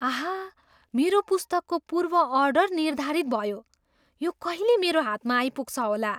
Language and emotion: Nepali, surprised